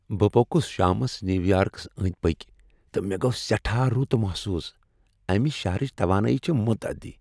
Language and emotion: Kashmiri, happy